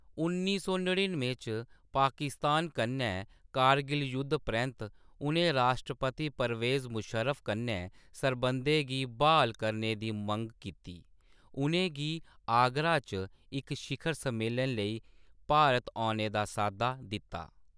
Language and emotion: Dogri, neutral